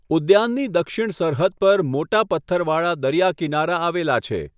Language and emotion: Gujarati, neutral